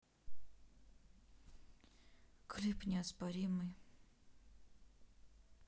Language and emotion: Russian, neutral